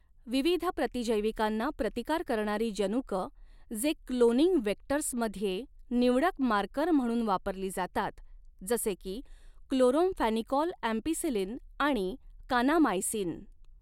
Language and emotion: Marathi, neutral